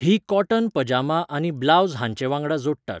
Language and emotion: Goan Konkani, neutral